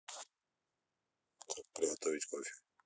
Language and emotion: Russian, neutral